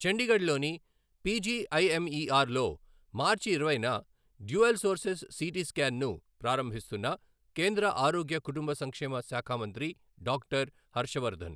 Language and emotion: Telugu, neutral